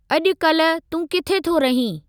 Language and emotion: Sindhi, neutral